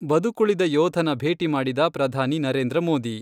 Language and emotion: Kannada, neutral